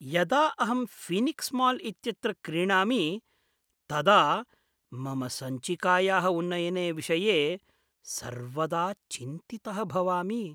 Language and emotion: Sanskrit, fearful